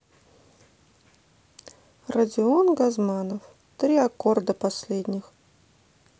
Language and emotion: Russian, neutral